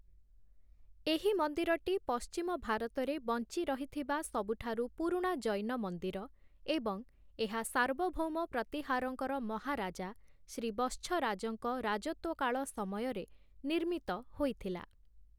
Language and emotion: Odia, neutral